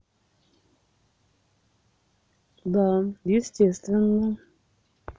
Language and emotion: Russian, neutral